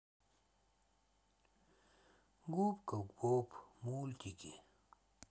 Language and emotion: Russian, sad